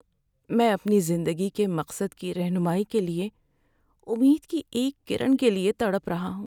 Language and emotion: Urdu, sad